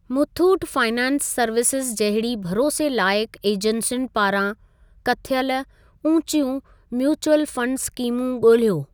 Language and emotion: Sindhi, neutral